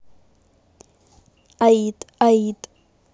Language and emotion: Russian, neutral